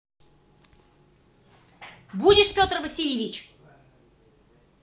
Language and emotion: Russian, angry